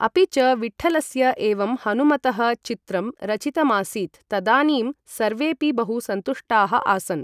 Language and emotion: Sanskrit, neutral